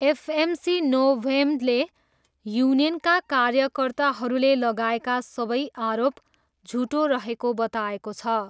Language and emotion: Nepali, neutral